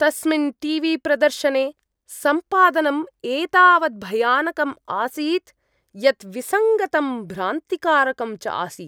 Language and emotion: Sanskrit, disgusted